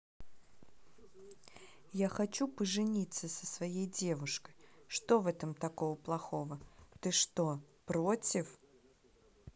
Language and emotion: Russian, neutral